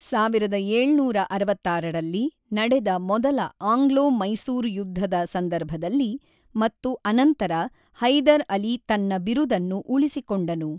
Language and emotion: Kannada, neutral